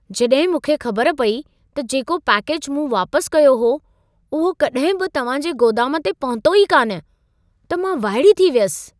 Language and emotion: Sindhi, surprised